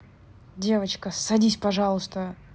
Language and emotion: Russian, angry